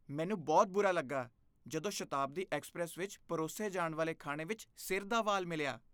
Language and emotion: Punjabi, disgusted